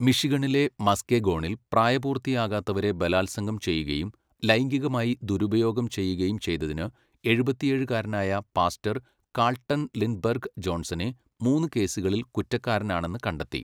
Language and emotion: Malayalam, neutral